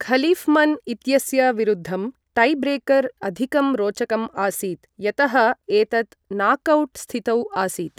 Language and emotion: Sanskrit, neutral